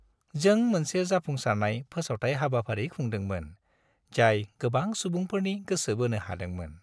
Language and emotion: Bodo, happy